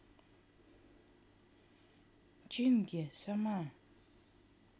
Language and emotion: Russian, neutral